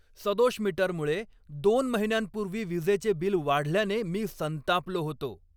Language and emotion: Marathi, angry